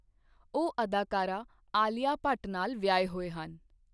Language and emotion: Punjabi, neutral